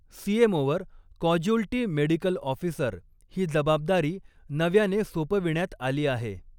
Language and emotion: Marathi, neutral